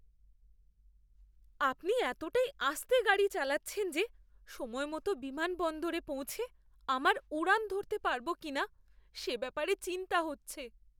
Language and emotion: Bengali, fearful